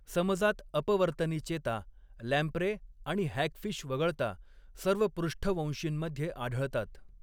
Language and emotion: Marathi, neutral